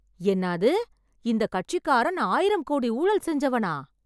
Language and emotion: Tamil, surprised